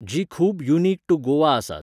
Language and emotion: Goan Konkani, neutral